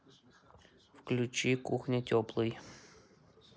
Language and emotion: Russian, neutral